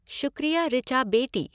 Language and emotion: Hindi, neutral